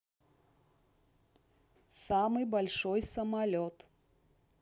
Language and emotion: Russian, neutral